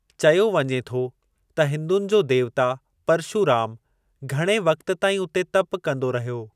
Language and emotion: Sindhi, neutral